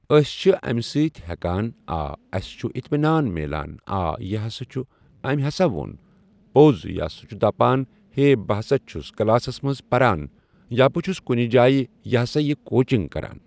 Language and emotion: Kashmiri, neutral